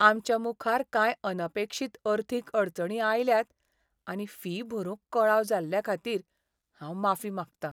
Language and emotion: Goan Konkani, sad